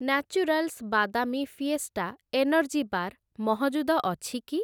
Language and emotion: Odia, neutral